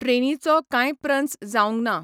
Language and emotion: Goan Konkani, neutral